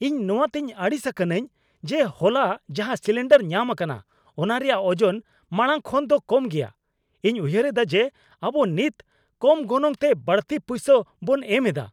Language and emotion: Santali, angry